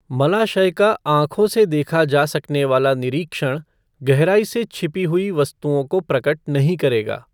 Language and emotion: Hindi, neutral